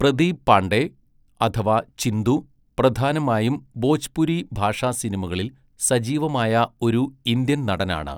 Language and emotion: Malayalam, neutral